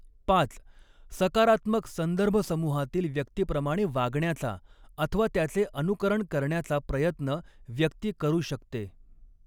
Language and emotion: Marathi, neutral